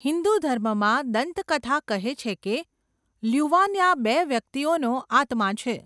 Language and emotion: Gujarati, neutral